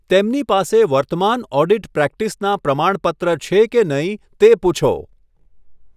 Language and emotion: Gujarati, neutral